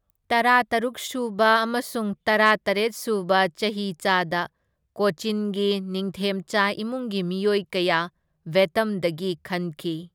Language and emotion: Manipuri, neutral